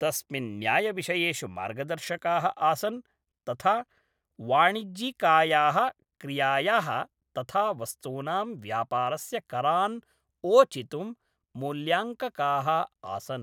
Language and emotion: Sanskrit, neutral